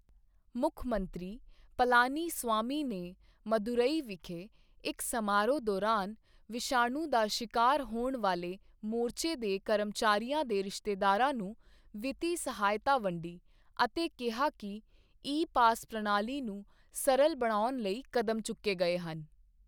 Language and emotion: Punjabi, neutral